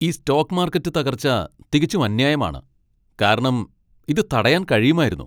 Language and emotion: Malayalam, angry